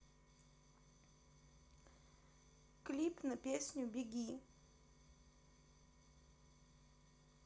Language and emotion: Russian, neutral